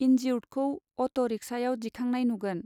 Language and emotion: Bodo, neutral